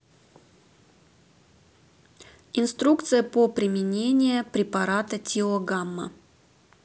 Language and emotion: Russian, neutral